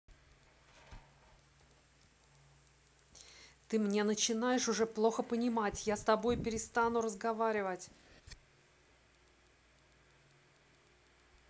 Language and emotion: Russian, angry